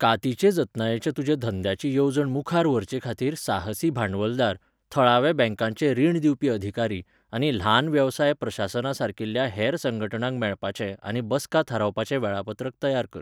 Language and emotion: Goan Konkani, neutral